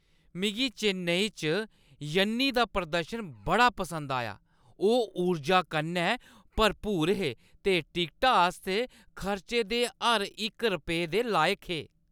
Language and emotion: Dogri, happy